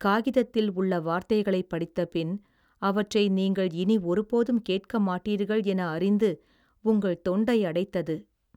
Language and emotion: Tamil, sad